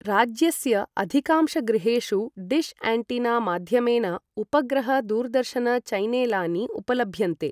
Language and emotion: Sanskrit, neutral